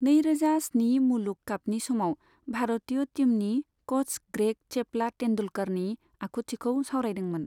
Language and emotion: Bodo, neutral